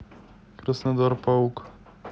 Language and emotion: Russian, neutral